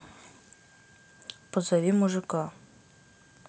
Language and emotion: Russian, neutral